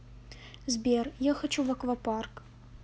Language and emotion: Russian, sad